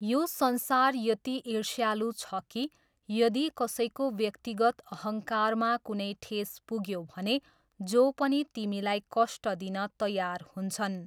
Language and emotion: Nepali, neutral